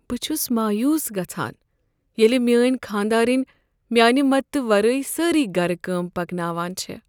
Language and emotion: Kashmiri, sad